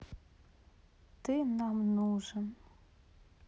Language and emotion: Russian, sad